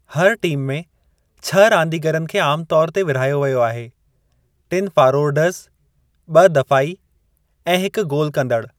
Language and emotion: Sindhi, neutral